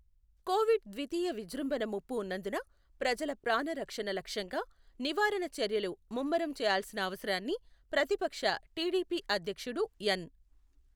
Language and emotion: Telugu, neutral